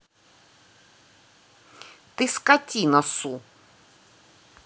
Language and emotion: Russian, angry